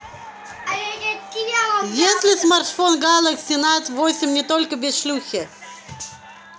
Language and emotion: Russian, neutral